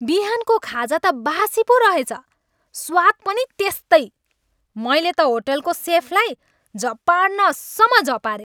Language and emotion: Nepali, angry